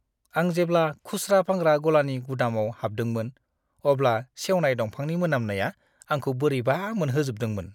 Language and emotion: Bodo, disgusted